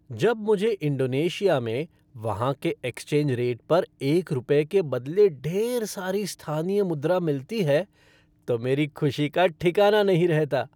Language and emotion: Hindi, happy